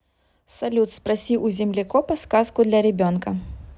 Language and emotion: Russian, neutral